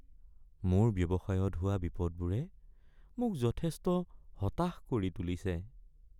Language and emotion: Assamese, sad